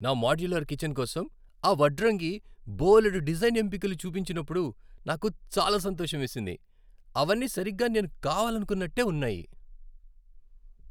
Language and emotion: Telugu, happy